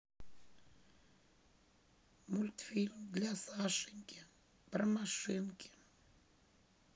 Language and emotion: Russian, sad